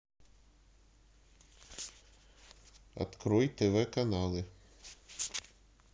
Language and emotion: Russian, neutral